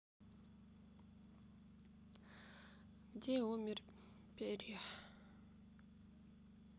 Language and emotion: Russian, sad